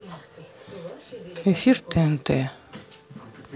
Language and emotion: Russian, neutral